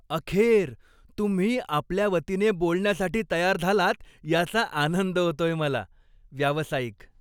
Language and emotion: Marathi, happy